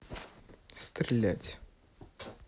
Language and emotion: Russian, neutral